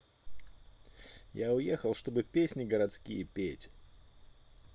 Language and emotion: Russian, neutral